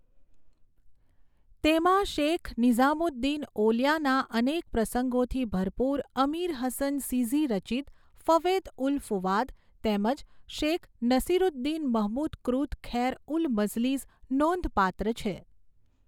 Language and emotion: Gujarati, neutral